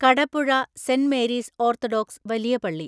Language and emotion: Malayalam, neutral